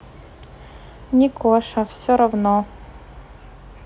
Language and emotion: Russian, neutral